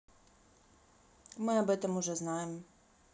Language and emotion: Russian, neutral